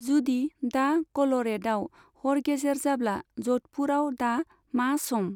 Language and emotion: Bodo, neutral